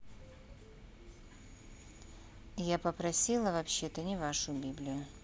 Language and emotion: Russian, neutral